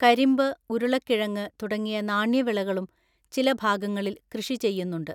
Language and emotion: Malayalam, neutral